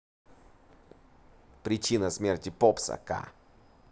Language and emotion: Russian, positive